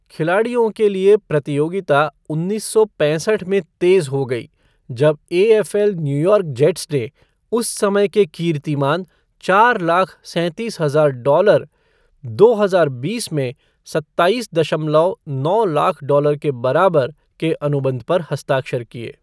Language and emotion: Hindi, neutral